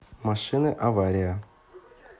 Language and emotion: Russian, neutral